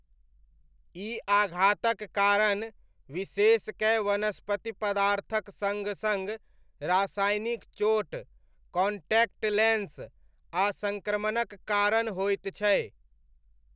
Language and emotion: Maithili, neutral